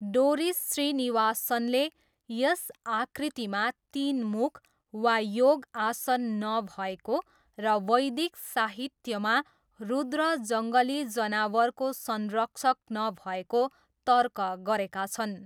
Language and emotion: Nepali, neutral